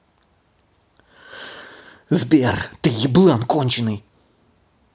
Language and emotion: Russian, angry